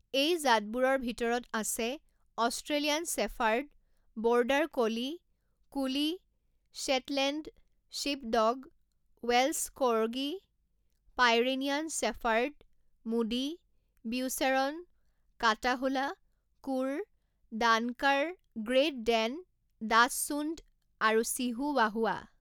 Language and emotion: Assamese, neutral